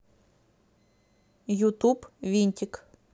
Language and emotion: Russian, neutral